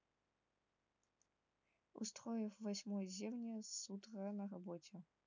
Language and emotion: Russian, neutral